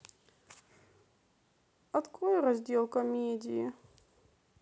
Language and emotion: Russian, sad